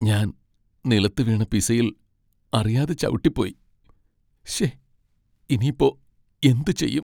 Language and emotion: Malayalam, sad